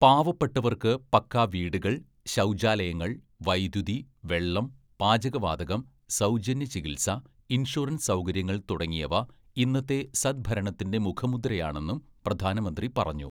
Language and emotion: Malayalam, neutral